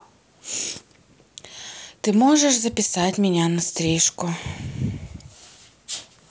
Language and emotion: Russian, sad